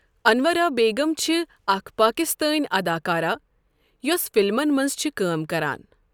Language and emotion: Kashmiri, neutral